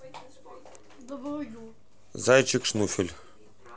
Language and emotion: Russian, neutral